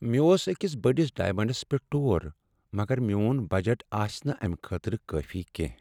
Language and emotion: Kashmiri, sad